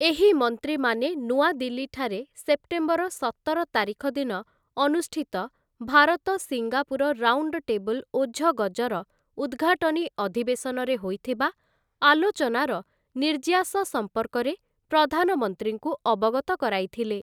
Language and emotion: Odia, neutral